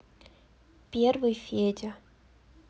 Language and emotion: Russian, neutral